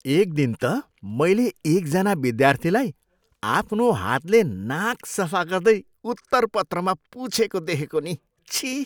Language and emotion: Nepali, disgusted